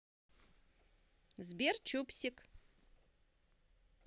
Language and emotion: Russian, positive